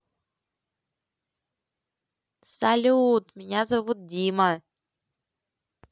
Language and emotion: Russian, positive